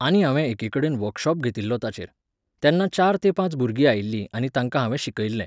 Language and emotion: Goan Konkani, neutral